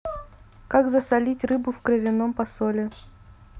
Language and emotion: Russian, neutral